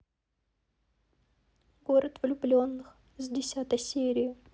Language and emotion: Russian, sad